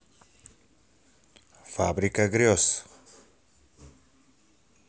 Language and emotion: Russian, positive